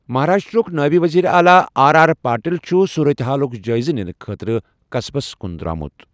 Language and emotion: Kashmiri, neutral